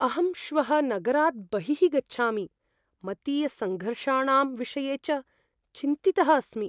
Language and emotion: Sanskrit, fearful